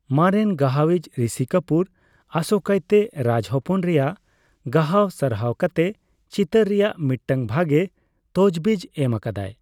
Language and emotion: Santali, neutral